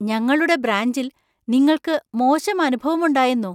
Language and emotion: Malayalam, surprised